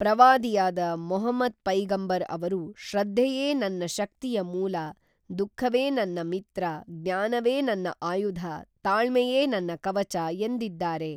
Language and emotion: Kannada, neutral